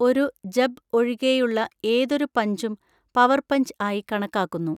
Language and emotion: Malayalam, neutral